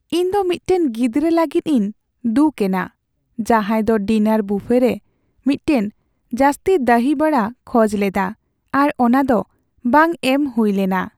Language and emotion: Santali, sad